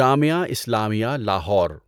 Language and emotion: Urdu, neutral